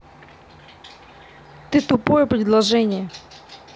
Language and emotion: Russian, angry